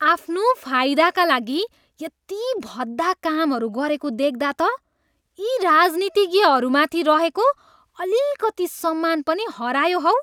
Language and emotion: Nepali, disgusted